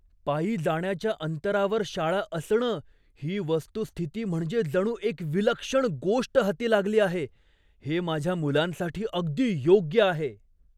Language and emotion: Marathi, surprised